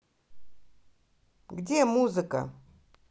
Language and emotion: Russian, angry